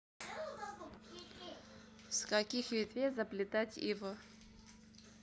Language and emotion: Russian, neutral